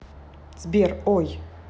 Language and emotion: Russian, neutral